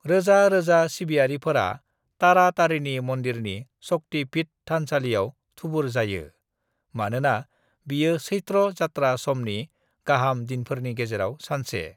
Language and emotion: Bodo, neutral